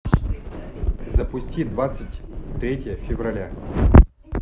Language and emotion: Russian, neutral